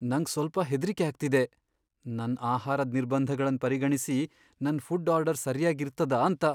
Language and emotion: Kannada, fearful